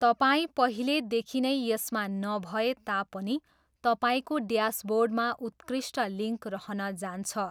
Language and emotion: Nepali, neutral